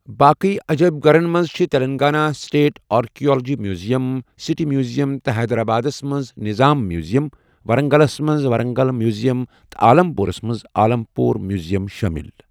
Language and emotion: Kashmiri, neutral